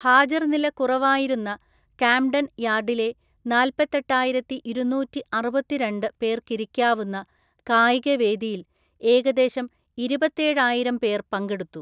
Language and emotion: Malayalam, neutral